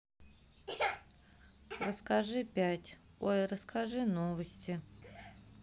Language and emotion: Russian, sad